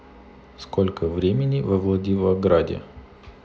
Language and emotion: Russian, neutral